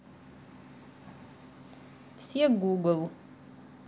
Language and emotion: Russian, neutral